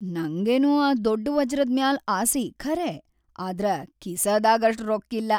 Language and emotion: Kannada, sad